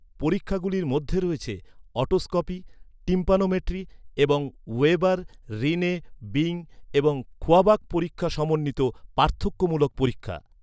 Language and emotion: Bengali, neutral